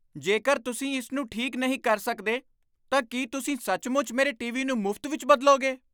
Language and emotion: Punjabi, surprised